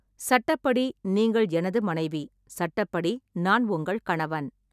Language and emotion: Tamil, neutral